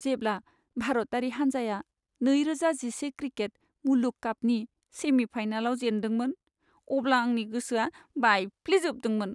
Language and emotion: Bodo, sad